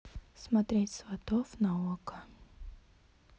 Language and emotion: Russian, neutral